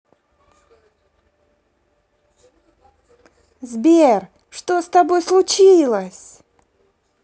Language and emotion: Russian, positive